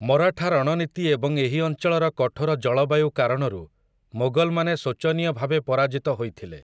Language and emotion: Odia, neutral